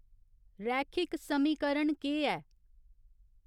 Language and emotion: Dogri, neutral